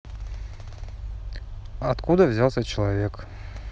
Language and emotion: Russian, neutral